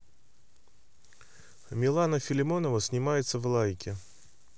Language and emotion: Russian, neutral